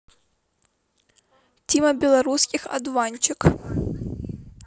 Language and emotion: Russian, neutral